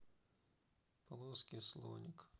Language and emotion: Russian, sad